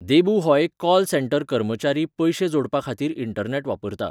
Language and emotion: Goan Konkani, neutral